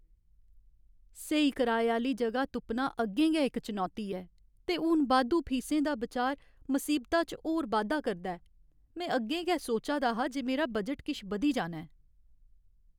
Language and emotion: Dogri, sad